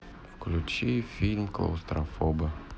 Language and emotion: Russian, neutral